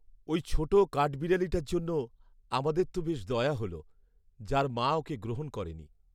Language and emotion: Bengali, sad